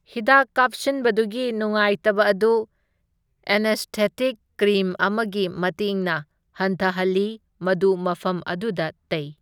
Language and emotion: Manipuri, neutral